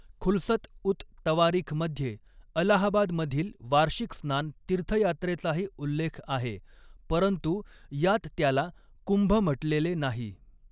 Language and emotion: Marathi, neutral